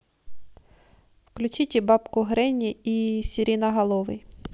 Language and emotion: Russian, neutral